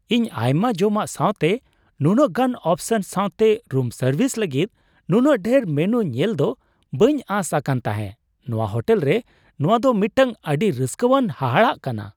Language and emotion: Santali, surprised